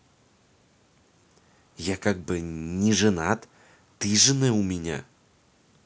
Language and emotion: Russian, neutral